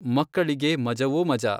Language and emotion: Kannada, neutral